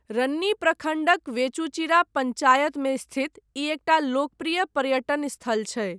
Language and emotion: Maithili, neutral